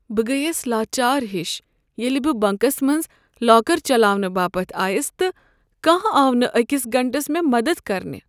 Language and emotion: Kashmiri, sad